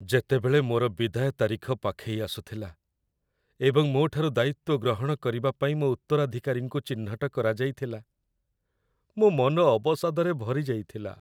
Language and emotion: Odia, sad